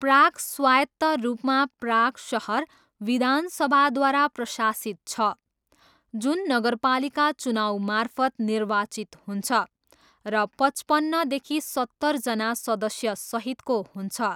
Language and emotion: Nepali, neutral